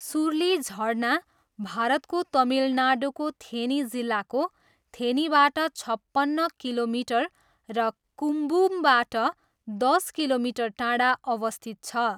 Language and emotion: Nepali, neutral